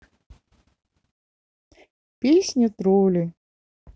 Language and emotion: Russian, sad